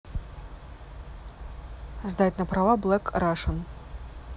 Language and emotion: Russian, neutral